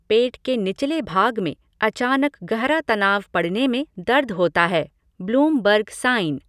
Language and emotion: Hindi, neutral